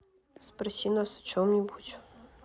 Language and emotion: Russian, neutral